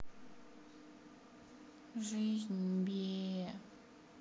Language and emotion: Russian, sad